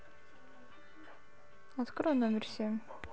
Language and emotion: Russian, neutral